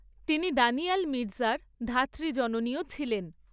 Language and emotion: Bengali, neutral